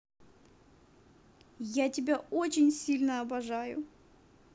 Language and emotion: Russian, positive